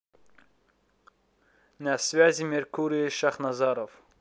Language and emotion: Russian, neutral